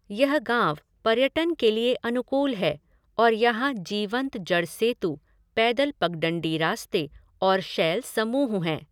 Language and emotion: Hindi, neutral